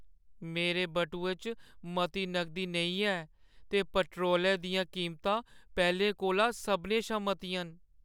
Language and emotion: Dogri, sad